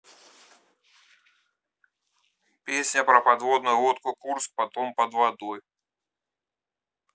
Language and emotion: Russian, neutral